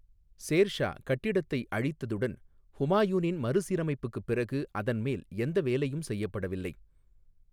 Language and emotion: Tamil, neutral